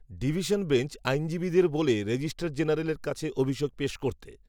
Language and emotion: Bengali, neutral